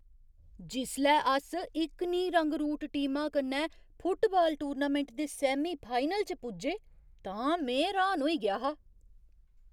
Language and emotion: Dogri, surprised